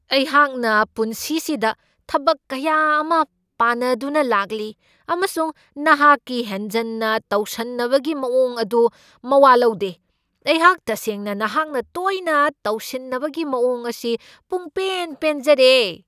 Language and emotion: Manipuri, angry